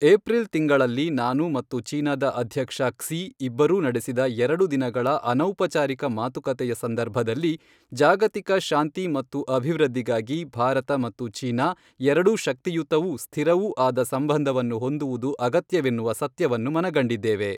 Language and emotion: Kannada, neutral